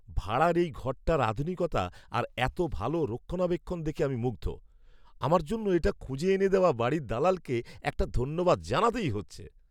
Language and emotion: Bengali, surprised